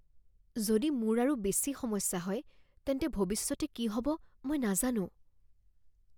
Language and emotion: Assamese, fearful